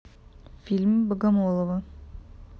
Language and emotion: Russian, neutral